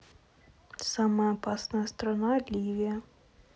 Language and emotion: Russian, neutral